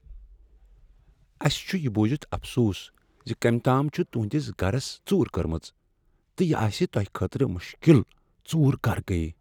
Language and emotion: Kashmiri, sad